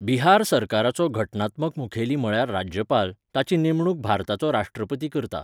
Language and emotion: Goan Konkani, neutral